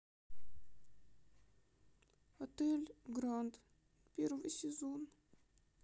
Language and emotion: Russian, sad